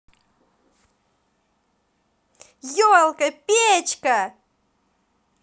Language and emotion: Russian, positive